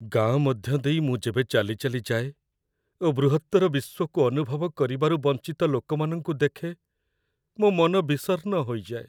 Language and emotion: Odia, sad